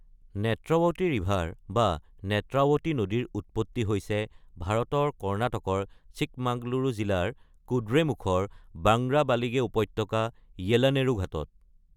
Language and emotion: Assamese, neutral